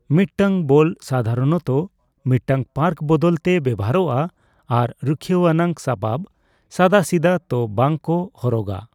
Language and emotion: Santali, neutral